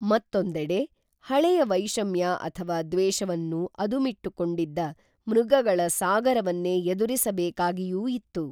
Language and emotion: Kannada, neutral